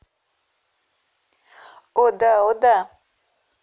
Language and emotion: Russian, positive